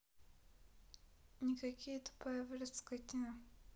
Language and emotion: Russian, sad